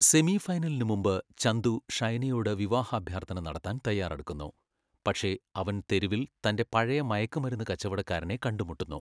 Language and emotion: Malayalam, neutral